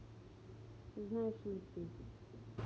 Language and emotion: Russian, neutral